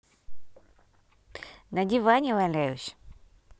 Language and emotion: Russian, neutral